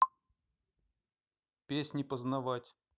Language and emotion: Russian, neutral